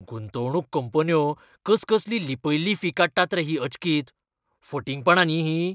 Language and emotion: Goan Konkani, angry